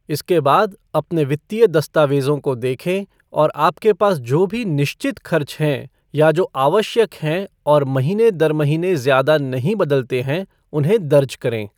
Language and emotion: Hindi, neutral